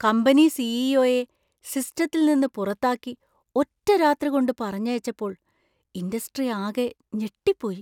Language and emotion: Malayalam, surprised